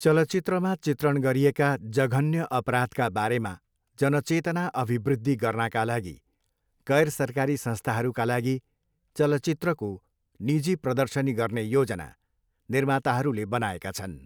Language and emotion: Nepali, neutral